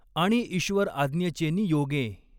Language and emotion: Marathi, neutral